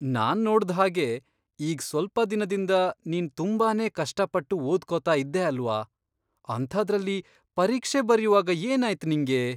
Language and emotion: Kannada, surprised